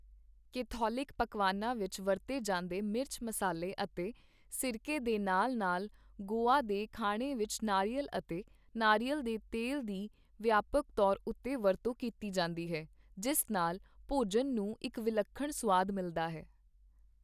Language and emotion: Punjabi, neutral